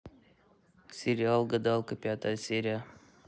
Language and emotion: Russian, neutral